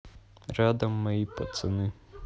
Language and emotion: Russian, neutral